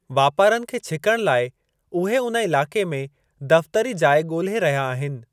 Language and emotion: Sindhi, neutral